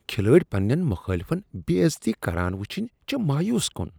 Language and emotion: Kashmiri, disgusted